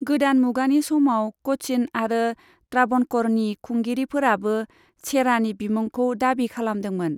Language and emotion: Bodo, neutral